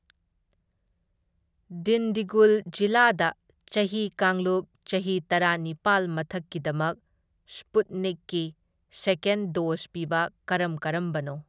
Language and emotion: Manipuri, neutral